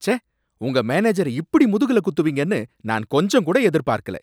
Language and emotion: Tamil, angry